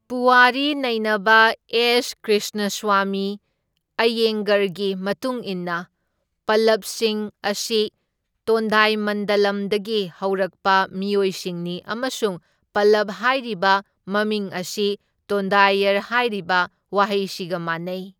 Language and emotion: Manipuri, neutral